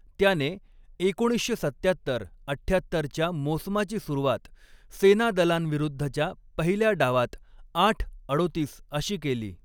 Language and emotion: Marathi, neutral